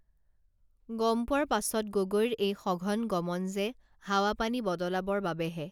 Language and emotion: Assamese, neutral